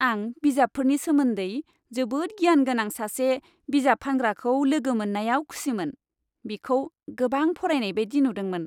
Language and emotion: Bodo, happy